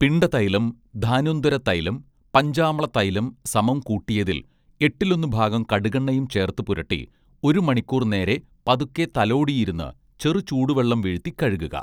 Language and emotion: Malayalam, neutral